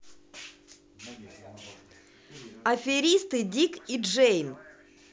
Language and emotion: Russian, positive